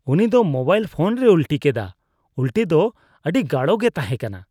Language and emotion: Santali, disgusted